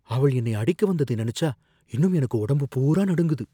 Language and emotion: Tamil, fearful